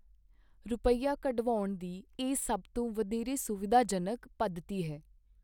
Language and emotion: Punjabi, neutral